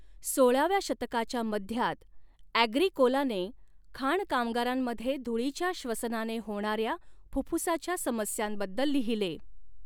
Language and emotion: Marathi, neutral